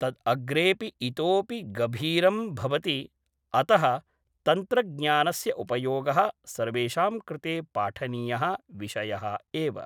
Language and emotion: Sanskrit, neutral